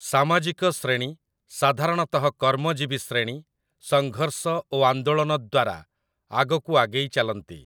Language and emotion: Odia, neutral